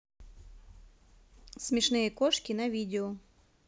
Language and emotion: Russian, neutral